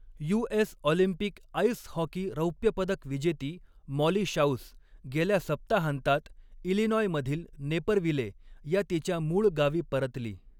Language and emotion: Marathi, neutral